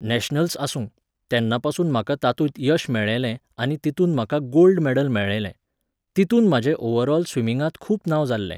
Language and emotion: Goan Konkani, neutral